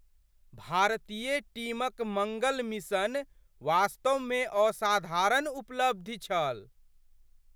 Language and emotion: Maithili, surprised